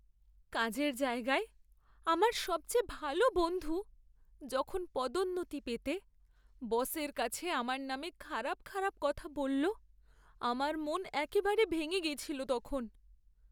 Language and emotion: Bengali, sad